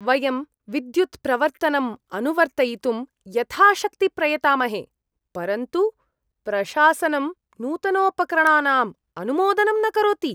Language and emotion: Sanskrit, disgusted